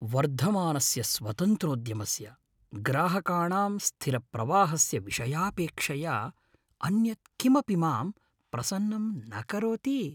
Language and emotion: Sanskrit, happy